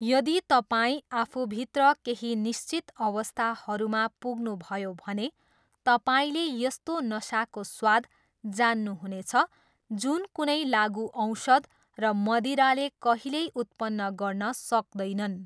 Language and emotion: Nepali, neutral